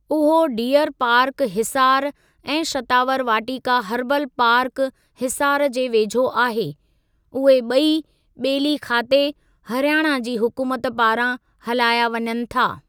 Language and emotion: Sindhi, neutral